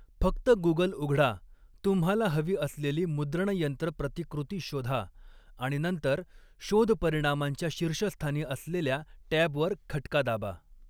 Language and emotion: Marathi, neutral